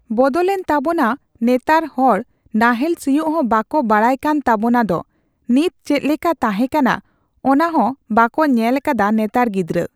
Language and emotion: Santali, neutral